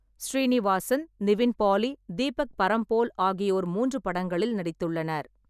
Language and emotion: Tamil, neutral